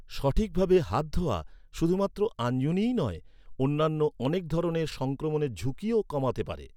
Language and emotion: Bengali, neutral